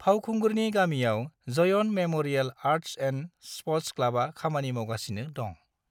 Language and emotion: Bodo, neutral